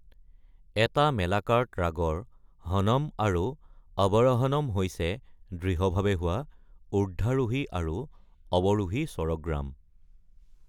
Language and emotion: Assamese, neutral